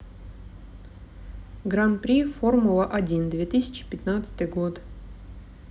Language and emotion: Russian, neutral